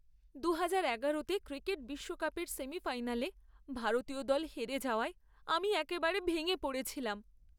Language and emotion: Bengali, sad